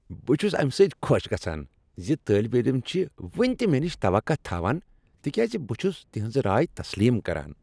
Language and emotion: Kashmiri, happy